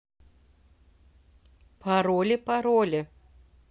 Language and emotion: Russian, neutral